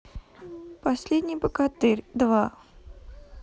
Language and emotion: Russian, neutral